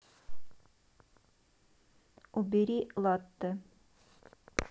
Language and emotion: Russian, neutral